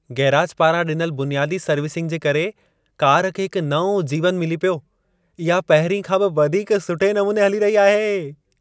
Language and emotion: Sindhi, happy